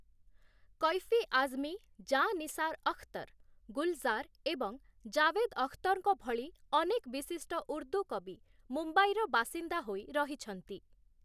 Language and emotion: Odia, neutral